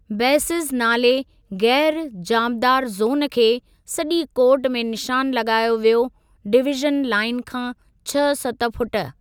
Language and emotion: Sindhi, neutral